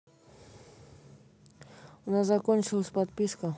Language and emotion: Russian, neutral